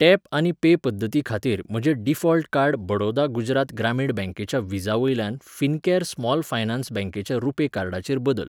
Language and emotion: Goan Konkani, neutral